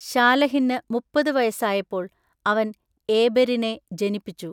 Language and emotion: Malayalam, neutral